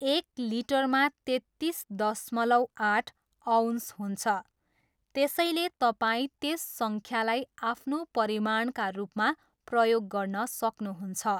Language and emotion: Nepali, neutral